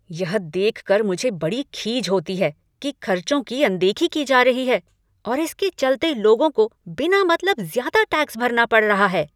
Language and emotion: Hindi, angry